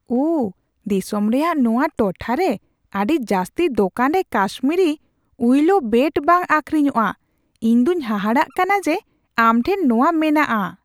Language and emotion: Santali, surprised